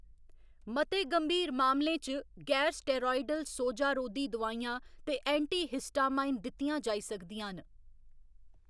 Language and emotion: Dogri, neutral